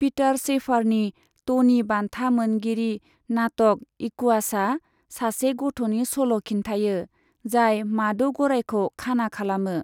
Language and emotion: Bodo, neutral